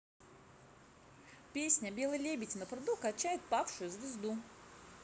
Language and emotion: Russian, positive